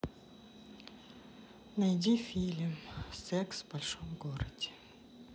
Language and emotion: Russian, sad